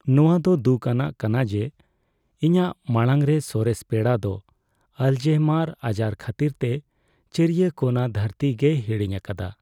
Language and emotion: Santali, sad